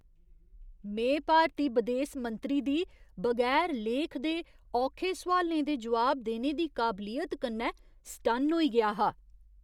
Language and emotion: Dogri, surprised